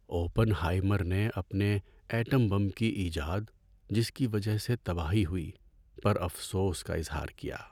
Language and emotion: Urdu, sad